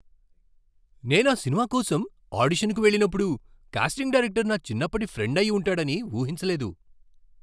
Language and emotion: Telugu, surprised